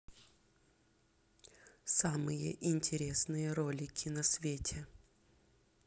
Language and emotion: Russian, neutral